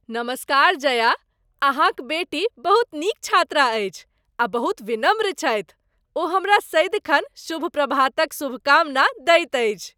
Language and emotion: Maithili, happy